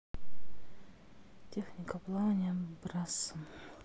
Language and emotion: Russian, sad